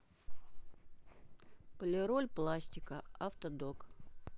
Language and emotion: Russian, neutral